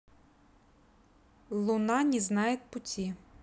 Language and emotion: Russian, neutral